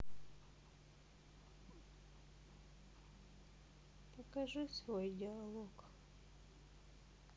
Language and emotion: Russian, sad